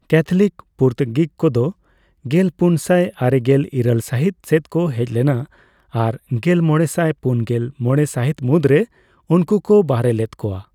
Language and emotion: Santali, neutral